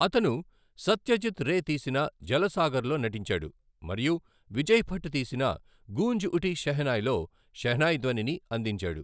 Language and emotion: Telugu, neutral